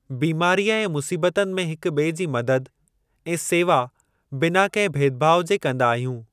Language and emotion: Sindhi, neutral